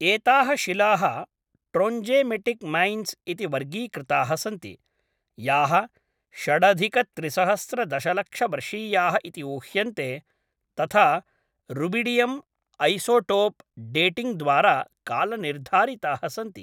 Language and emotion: Sanskrit, neutral